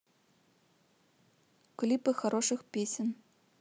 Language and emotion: Russian, neutral